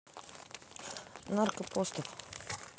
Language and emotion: Russian, neutral